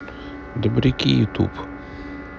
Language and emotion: Russian, neutral